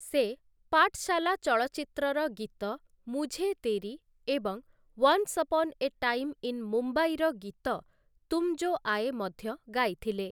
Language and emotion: Odia, neutral